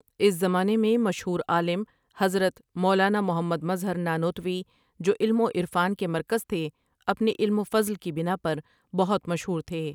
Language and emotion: Urdu, neutral